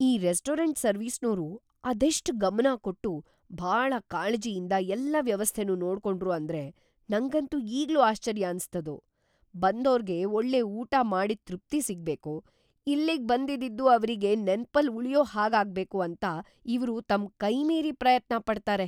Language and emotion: Kannada, surprised